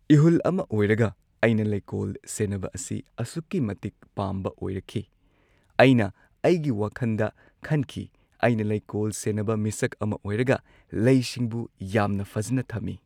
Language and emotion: Manipuri, neutral